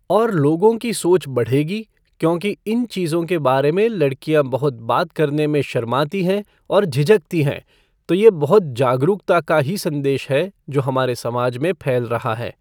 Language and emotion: Hindi, neutral